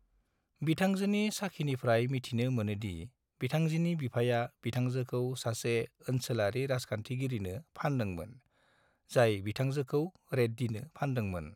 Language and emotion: Bodo, neutral